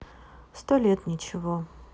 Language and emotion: Russian, sad